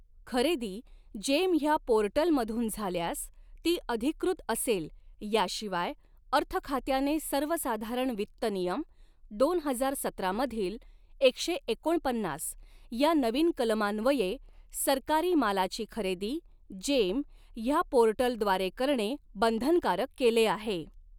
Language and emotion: Marathi, neutral